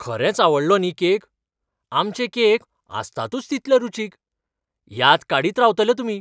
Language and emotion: Goan Konkani, surprised